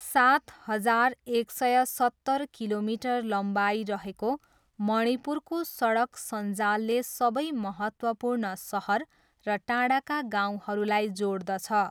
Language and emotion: Nepali, neutral